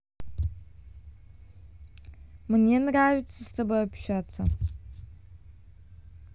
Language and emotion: Russian, neutral